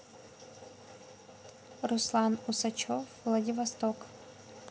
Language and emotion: Russian, neutral